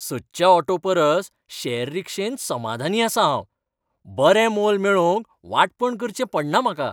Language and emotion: Goan Konkani, happy